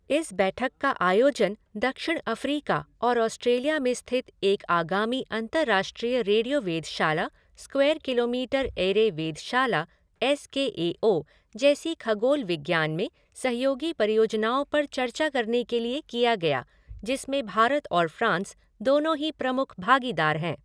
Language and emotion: Hindi, neutral